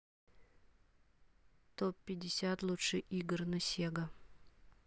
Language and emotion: Russian, neutral